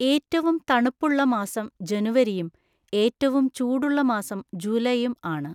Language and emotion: Malayalam, neutral